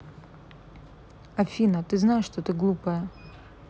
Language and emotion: Russian, neutral